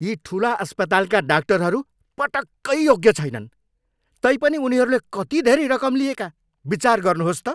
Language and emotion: Nepali, angry